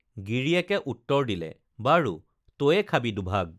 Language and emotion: Assamese, neutral